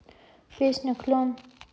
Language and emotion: Russian, neutral